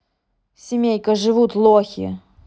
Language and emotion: Russian, angry